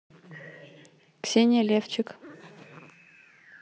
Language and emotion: Russian, neutral